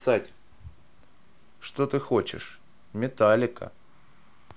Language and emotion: Russian, neutral